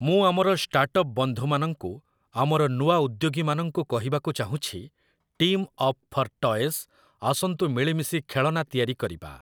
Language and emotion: Odia, neutral